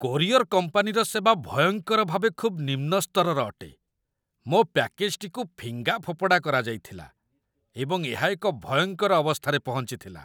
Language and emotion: Odia, disgusted